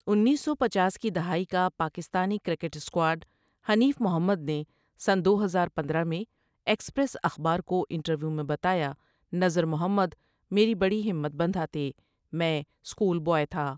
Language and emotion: Urdu, neutral